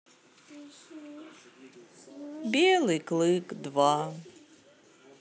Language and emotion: Russian, sad